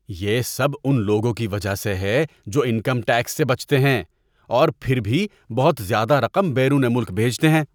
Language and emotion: Urdu, disgusted